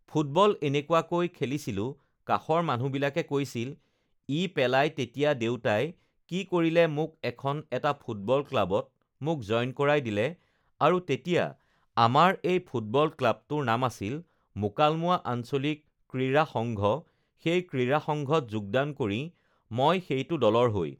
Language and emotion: Assamese, neutral